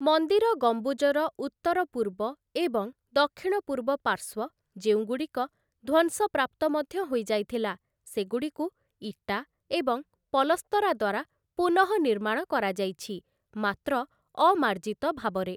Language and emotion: Odia, neutral